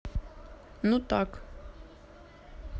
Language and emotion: Russian, neutral